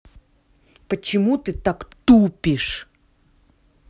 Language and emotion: Russian, angry